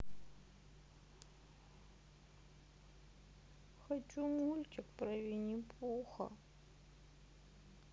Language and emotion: Russian, sad